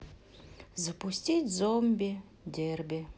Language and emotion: Russian, neutral